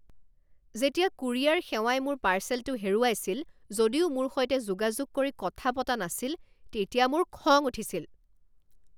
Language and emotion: Assamese, angry